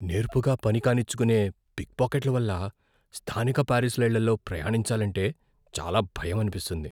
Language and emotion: Telugu, fearful